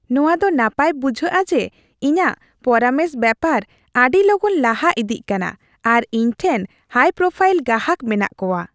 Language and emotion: Santali, happy